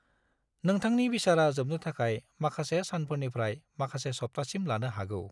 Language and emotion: Bodo, neutral